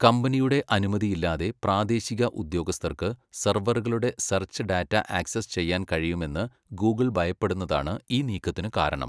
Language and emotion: Malayalam, neutral